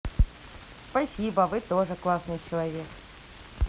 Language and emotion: Russian, positive